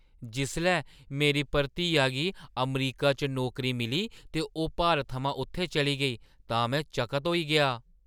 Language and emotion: Dogri, surprised